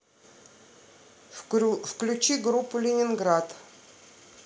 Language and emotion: Russian, neutral